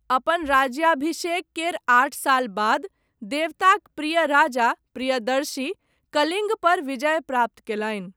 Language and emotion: Maithili, neutral